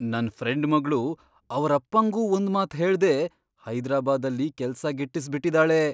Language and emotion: Kannada, surprised